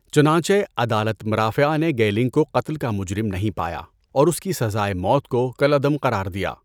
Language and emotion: Urdu, neutral